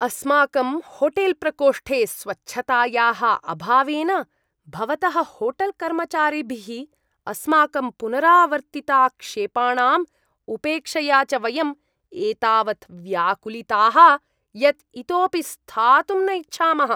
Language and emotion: Sanskrit, disgusted